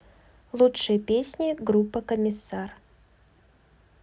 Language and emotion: Russian, neutral